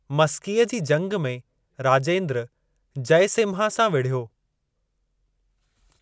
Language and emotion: Sindhi, neutral